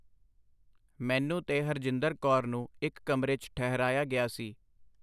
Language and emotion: Punjabi, neutral